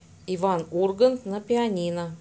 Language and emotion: Russian, neutral